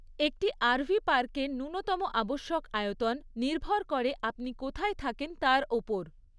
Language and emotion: Bengali, neutral